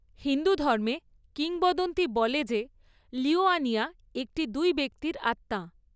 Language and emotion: Bengali, neutral